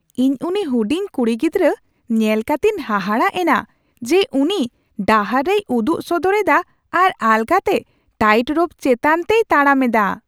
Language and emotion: Santali, surprised